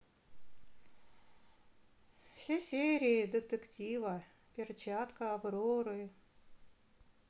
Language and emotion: Russian, sad